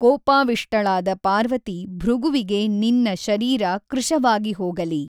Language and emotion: Kannada, neutral